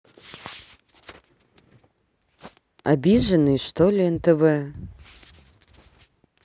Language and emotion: Russian, neutral